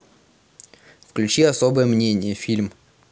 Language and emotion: Russian, neutral